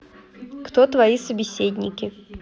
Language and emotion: Russian, neutral